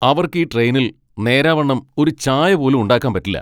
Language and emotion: Malayalam, angry